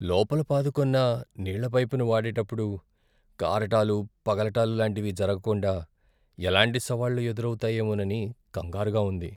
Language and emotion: Telugu, fearful